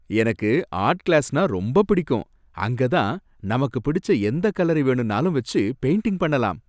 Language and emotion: Tamil, happy